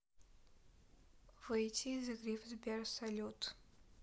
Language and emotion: Russian, neutral